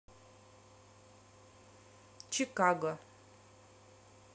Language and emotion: Russian, neutral